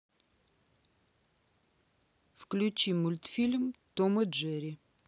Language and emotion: Russian, neutral